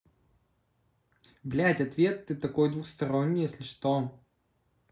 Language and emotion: Russian, neutral